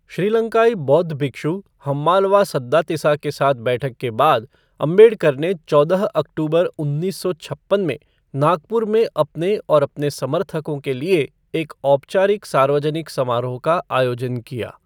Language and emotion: Hindi, neutral